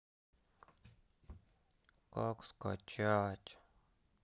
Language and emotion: Russian, sad